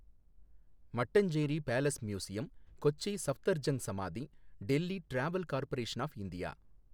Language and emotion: Tamil, neutral